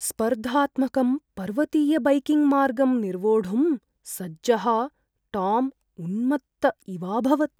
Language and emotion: Sanskrit, fearful